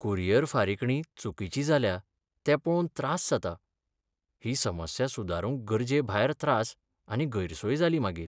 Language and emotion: Goan Konkani, sad